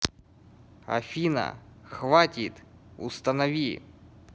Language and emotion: Russian, angry